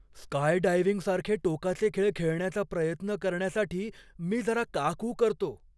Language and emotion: Marathi, fearful